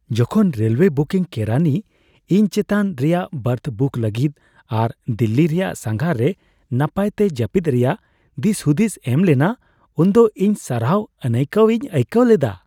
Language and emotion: Santali, happy